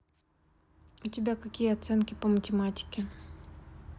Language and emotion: Russian, neutral